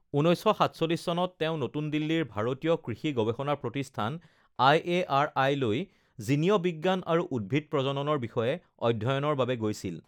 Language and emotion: Assamese, neutral